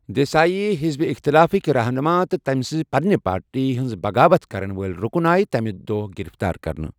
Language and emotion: Kashmiri, neutral